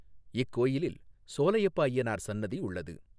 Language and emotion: Tamil, neutral